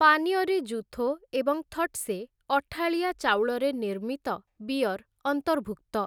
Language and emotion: Odia, neutral